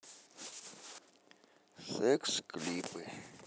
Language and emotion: Russian, neutral